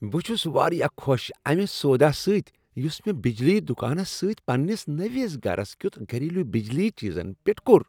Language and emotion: Kashmiri, happy